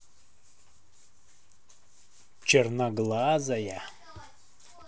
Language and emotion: Russian, neutral